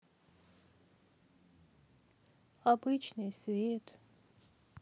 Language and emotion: Russian, sad